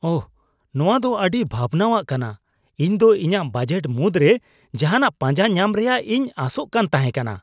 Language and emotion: Santali, disgusted